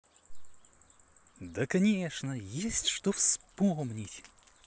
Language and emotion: Russian, positive